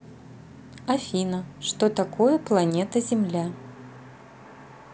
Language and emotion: Russian, neutral